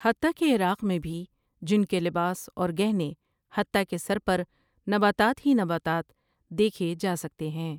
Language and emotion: Urdu, neutral